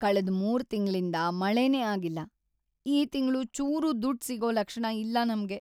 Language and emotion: Kannada, sad